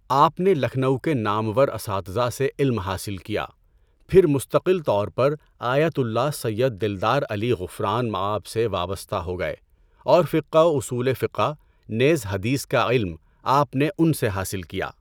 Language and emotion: Urdu, neutral